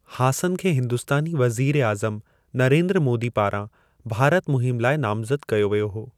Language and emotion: Sindhi, neutral